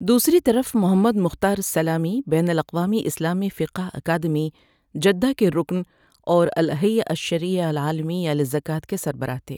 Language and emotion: Urdu, neutral